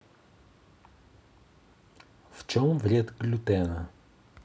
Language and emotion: Russian, neutral